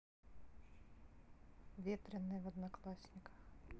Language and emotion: Russian, neutral